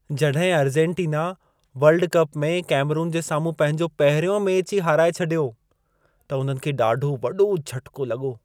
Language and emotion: Sindhi, surprised